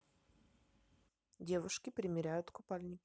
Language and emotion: Russian, neutral